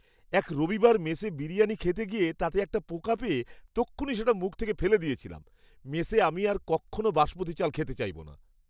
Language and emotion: Bengali, disgusted